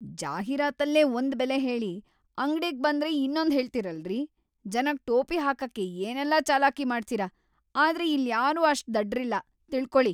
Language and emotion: Kannada, angry